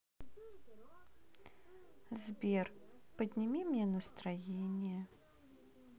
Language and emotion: Russian, sad